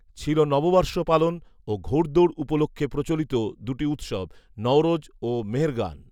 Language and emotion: Bengali, neutral